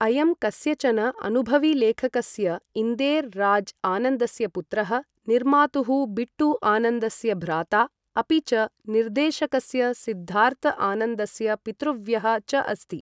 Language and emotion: Sanskrit, neutral